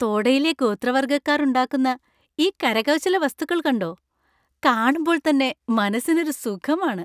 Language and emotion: Malayalam, happy